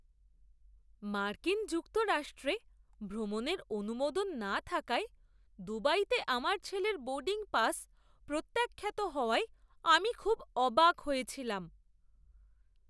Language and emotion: Bengali, surprised